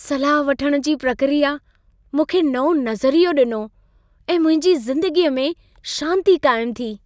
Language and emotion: Sindhi, happy